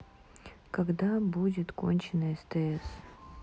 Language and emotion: Russian, sad